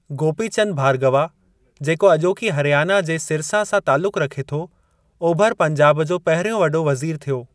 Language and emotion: Sindhi, neutral